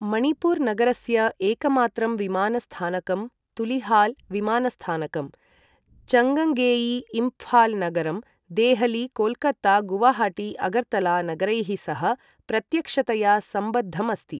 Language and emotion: Sanskrit, neutral